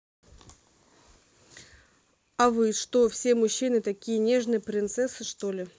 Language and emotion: Russian, neutral